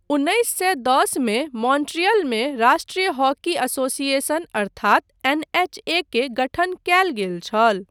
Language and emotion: Maithili, neutral